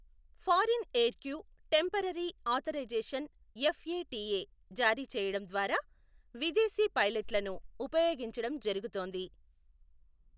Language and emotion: Telugu, neutral